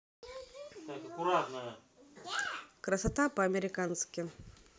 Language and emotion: Russian, neutral